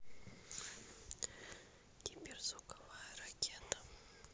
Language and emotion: Russian, neutral